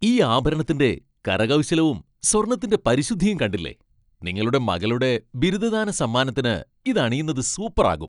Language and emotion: Malayalam, happy